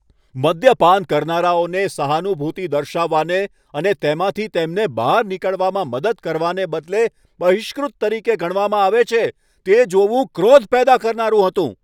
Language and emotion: Gujarati, angry